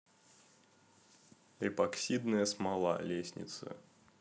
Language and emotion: Russian, neutral